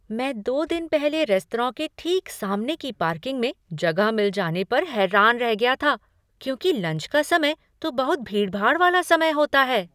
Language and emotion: Hindi, surprised